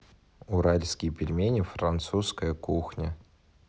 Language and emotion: Russian, neutral